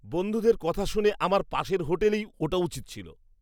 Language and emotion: Bengali, disgusted